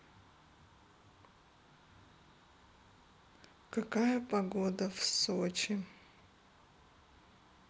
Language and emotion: Russian, sad